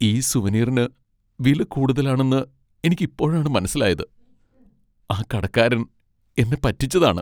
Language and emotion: Malayalam, sad